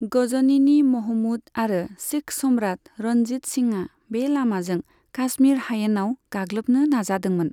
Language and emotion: Bodo, neutral